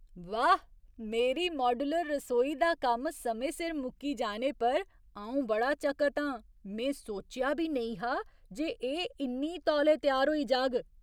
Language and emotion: Dogri, surprised